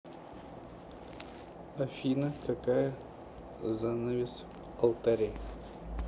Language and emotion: Russian, neutral